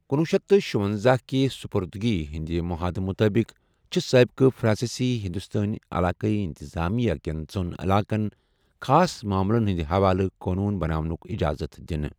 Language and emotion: Kashmiri, neutral